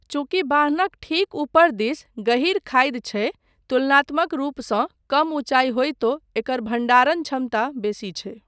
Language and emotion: Maithili, neutral